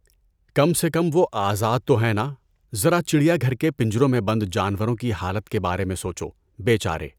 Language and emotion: Urdu, neutral